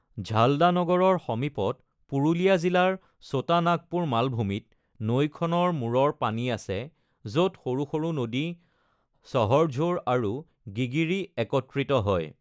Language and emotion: Assamese, neutral